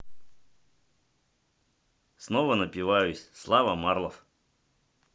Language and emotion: Russian, positive